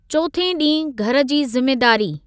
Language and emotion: Sindhi, neutral